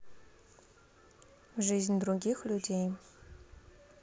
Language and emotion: Russian, neutral